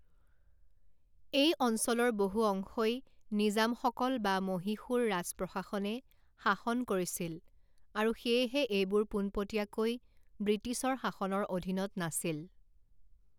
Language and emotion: Assamese, neutral